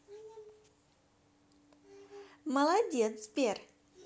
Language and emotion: Russian, positive